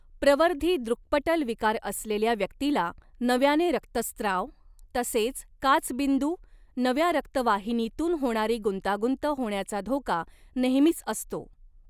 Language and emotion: Marathi, neutral